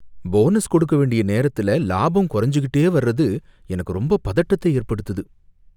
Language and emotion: Tamil, fearful